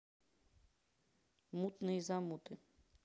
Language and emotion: Russian, neutral